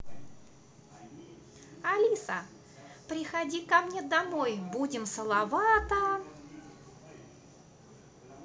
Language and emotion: Russian, positive